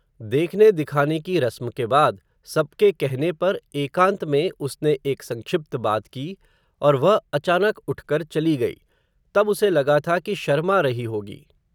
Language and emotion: Hindi, neutral